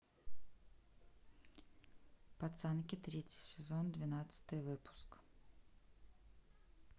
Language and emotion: Russian, neutral